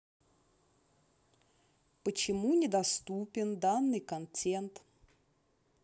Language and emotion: Russian, neutral